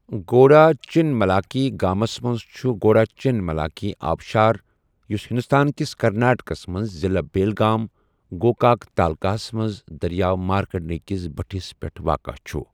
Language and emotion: Kashmiri, neutral